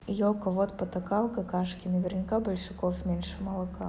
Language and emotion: Russian, neutral